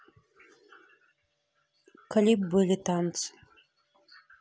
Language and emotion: Russian, neutral